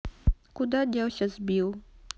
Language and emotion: Russian, neutral